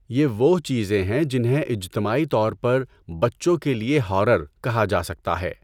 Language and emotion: Urdu, neutral